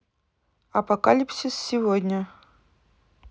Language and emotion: Russian, neutral